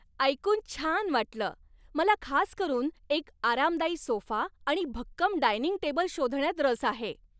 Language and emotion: Marathi, happy